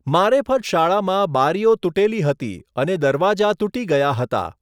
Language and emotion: Gujarati, neutral